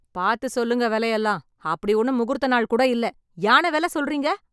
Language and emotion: Tamil, angry